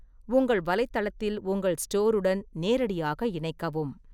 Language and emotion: Tamil, neutral